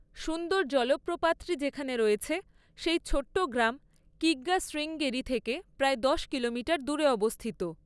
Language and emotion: Bengali, neutral